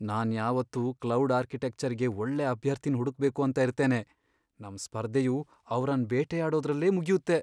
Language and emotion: Kannada, fearful